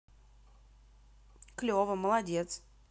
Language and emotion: Russian, positive